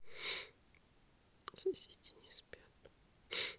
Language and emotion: Russian, sad